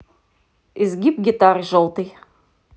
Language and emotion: Russian, neutral